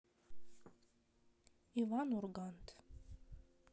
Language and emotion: Russian, neutral